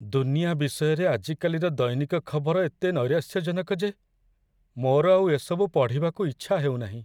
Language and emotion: Odia, sad